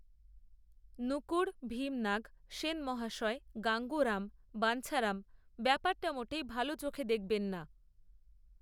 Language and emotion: Bengali, neutral